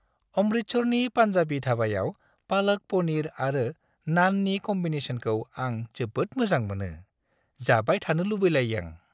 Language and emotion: Bodo, happy